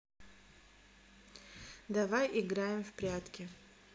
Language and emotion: Russian, neutral